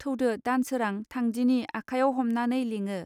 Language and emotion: Bodo, neutral